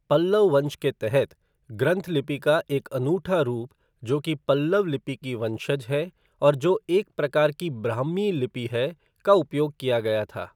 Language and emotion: Hindi, neutral